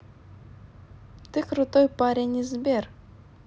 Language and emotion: Russian, positive